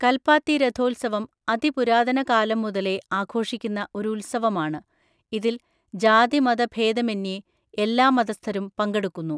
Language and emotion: Malayalam, neutral